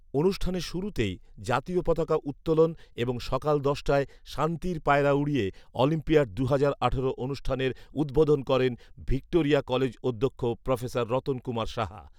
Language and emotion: Bengali, neutral